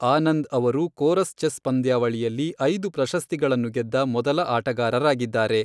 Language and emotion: Kannada, neutral